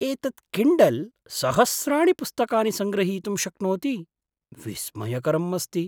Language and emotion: Sanskrit, surprised